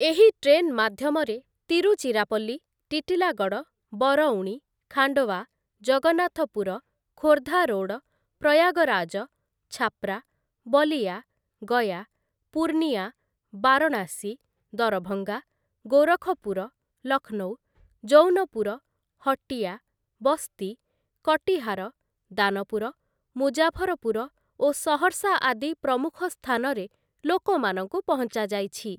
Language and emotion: Odia, neutral